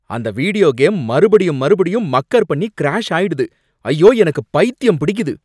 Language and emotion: Tamil, angry